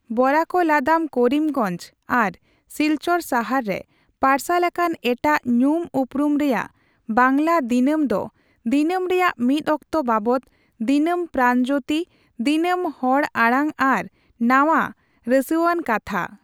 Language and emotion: Santali, neutral